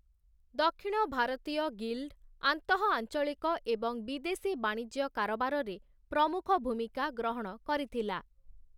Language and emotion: Odia, neutral